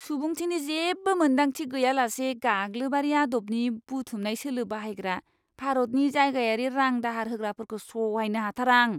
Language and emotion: Bodo, disgusted